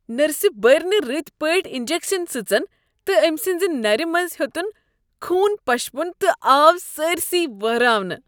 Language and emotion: Kashmiri, disgusted